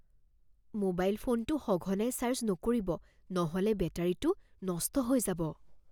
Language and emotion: Assamese, fearful